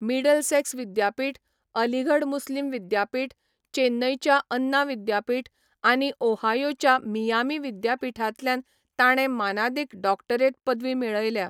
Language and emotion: Goan Konkani, neutral